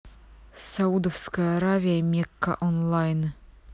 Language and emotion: Russian, neutral